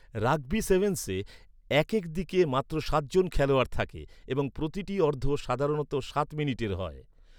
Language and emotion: Bengali, neutral